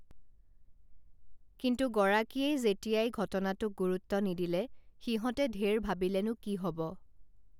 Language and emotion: Assamese, neutral